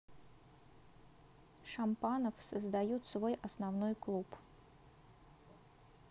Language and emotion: Russian, neutral